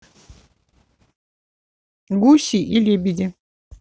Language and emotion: Russian, neutral